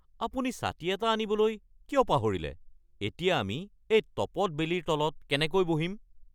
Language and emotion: Assamese, angry